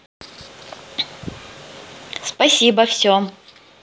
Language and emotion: Russian, positive